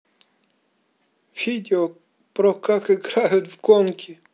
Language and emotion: Russian, neutral